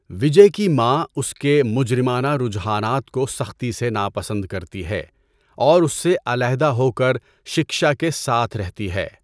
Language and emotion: Urdu, neutral